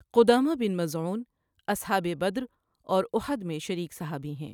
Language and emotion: Urdu, neutral